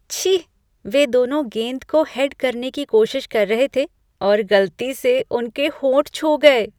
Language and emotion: Hindi, disgusted